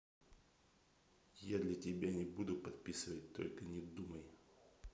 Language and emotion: Russian, angry